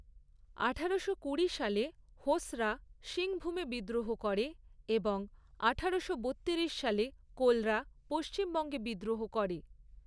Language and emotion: Bengali, neutral